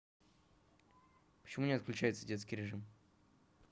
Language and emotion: Russian, neutral